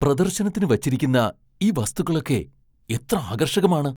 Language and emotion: Malayalam, surprised